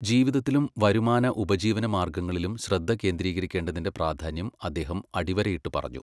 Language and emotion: Malayalam, neutral